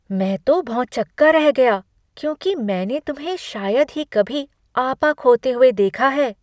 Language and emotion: Hindi, surprised